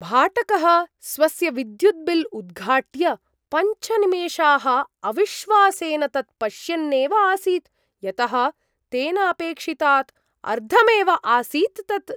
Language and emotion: Sanskrit, surprised